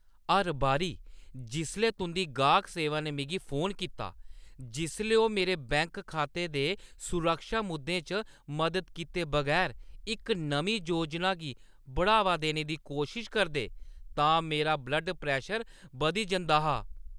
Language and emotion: Dogri, angry